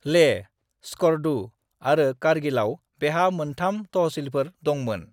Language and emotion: Bodo, neutral